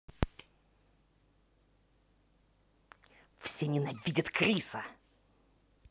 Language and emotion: Russian, angry